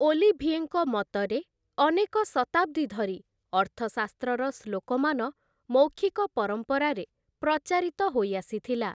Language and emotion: Odia, neutral